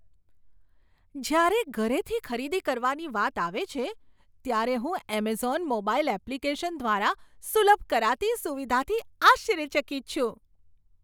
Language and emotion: Gujarati, surprised